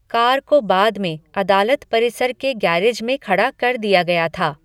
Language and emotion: Hindi, neutral